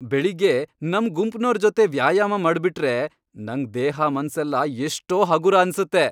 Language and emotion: Kannada, happy